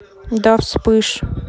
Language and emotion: Russian, neutral